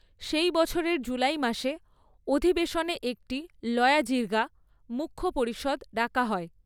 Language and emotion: Bengali, neutral